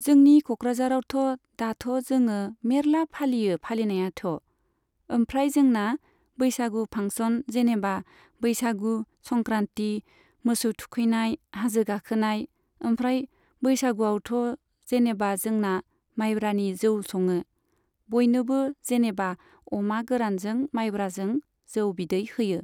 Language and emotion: Bodo, neutral